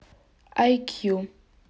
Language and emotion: Russian, neutral